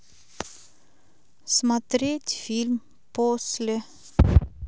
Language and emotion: Russian, neutral